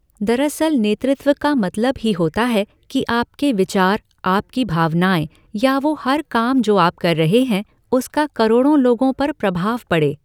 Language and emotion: Hindi, neutral